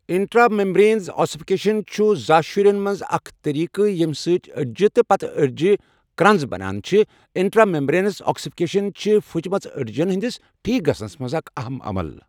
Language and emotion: Kashmiri, neutral